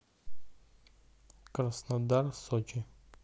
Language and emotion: Russian, neutral